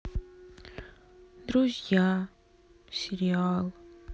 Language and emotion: Russian, sad